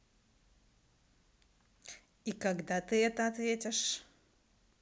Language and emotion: Russian, neutral